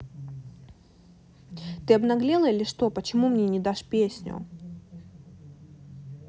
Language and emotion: Russian, angry